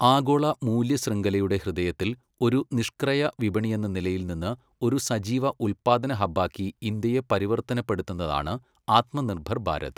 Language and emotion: Malayalam, neutral